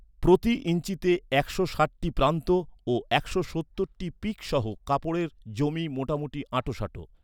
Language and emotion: Bengali, neutral